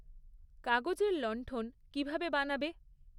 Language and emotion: Bengali, neutral